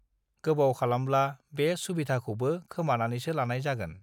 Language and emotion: Bodo, neutral